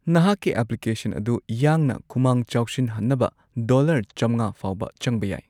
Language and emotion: Manipuri, neutral